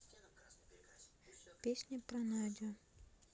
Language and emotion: Russian, sad